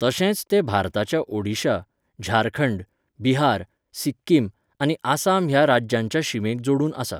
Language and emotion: Goan Konkani, neutral